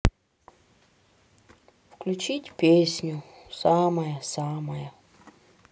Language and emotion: Russian, sad